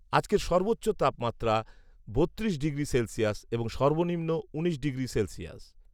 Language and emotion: Bengali, neutral